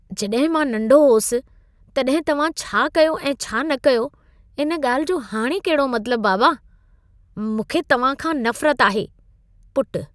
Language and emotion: Sindhi, disgusted